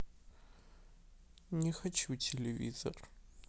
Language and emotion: Russian, sad